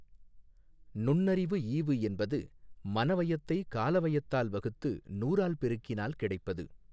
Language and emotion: Tamil, neutral